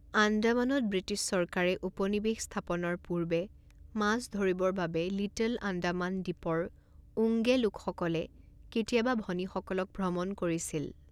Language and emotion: Assamese, neutral